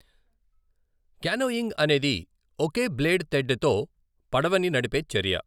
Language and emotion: Telugu, neutral